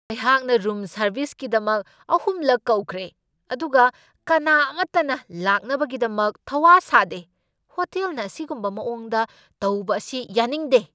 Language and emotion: Manipuri, angry